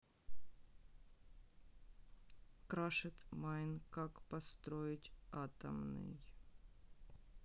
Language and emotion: Russian, sad